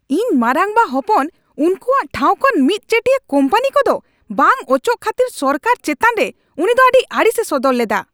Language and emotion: Santali, angry